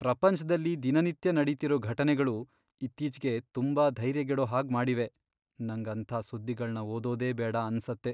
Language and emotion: Kannada, sad